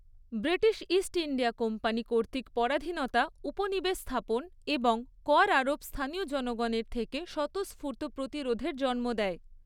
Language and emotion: Bengali, neutral